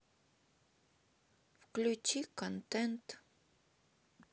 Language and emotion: Russian, sad